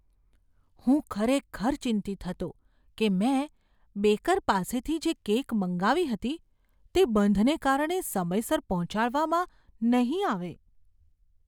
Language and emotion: Gujarati, fearful